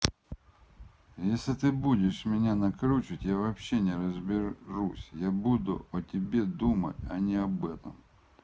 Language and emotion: Russian, angry